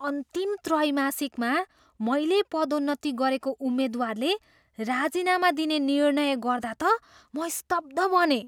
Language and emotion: Nepali, surprised